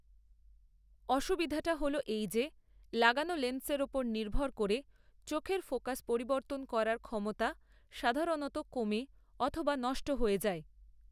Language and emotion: Bengali, neutral